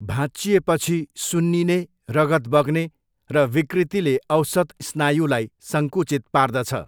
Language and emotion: Nepali, neutral